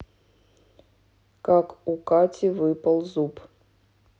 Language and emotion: Russian, neutral